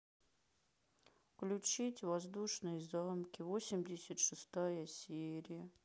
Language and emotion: Russian, sad